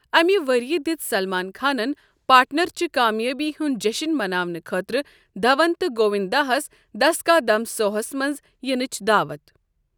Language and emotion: Kashmiri, neutral